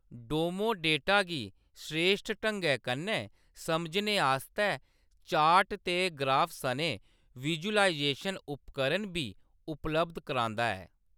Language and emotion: Dogri, neutral